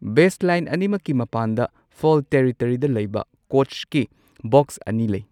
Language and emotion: Manipuri, neutral